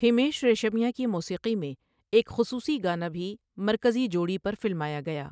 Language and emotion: Urdu, neutral